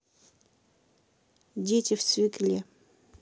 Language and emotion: Russian, neutral